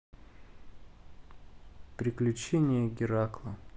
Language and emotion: Russian, neutral